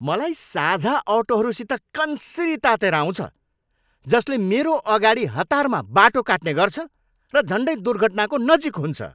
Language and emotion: Nepali, angry